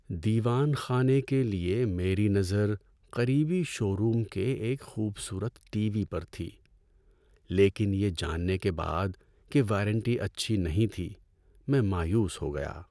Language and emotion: Urdu, sad